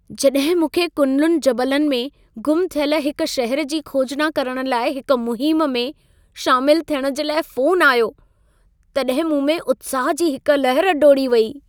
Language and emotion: Sindhi, happy